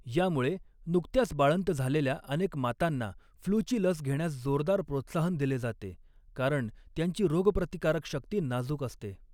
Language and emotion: Marathi, neutral